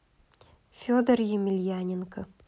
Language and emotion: Russian, neutral